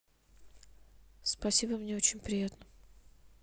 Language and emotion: Russian, neutral